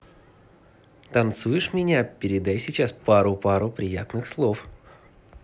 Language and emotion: Russian, positive